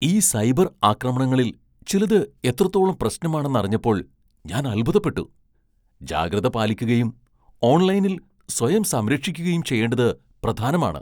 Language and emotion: Malayalam, surprised